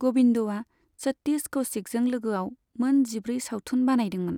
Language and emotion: Bodo, neutral